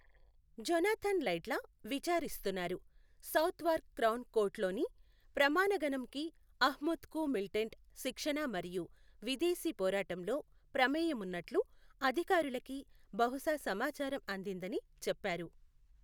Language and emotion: Telugu, neutral